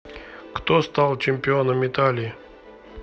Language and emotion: Russian, neutral